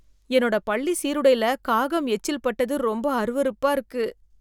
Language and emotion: Tamil, disgusted